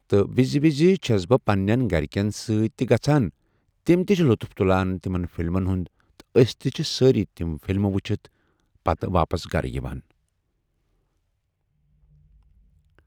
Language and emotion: Kashmiri, neutral